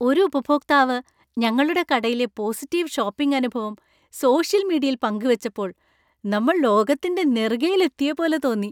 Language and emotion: Malayalam, happy